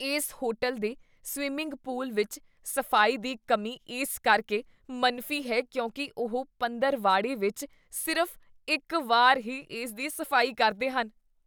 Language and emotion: Punjabi, disgusted